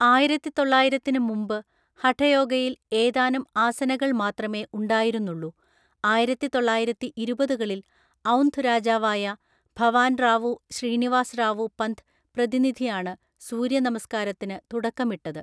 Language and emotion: Malayalam, neutral